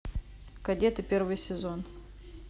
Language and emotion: Russian, neutral